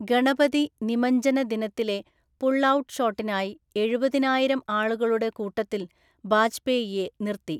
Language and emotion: Malayalam, neutral